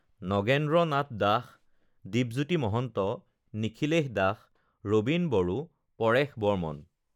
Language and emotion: Assamese, neutral